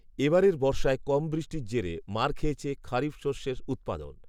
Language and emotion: Bengali, neutral